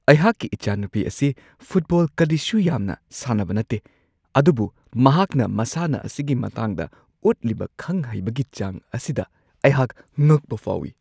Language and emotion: Manipuri, surprised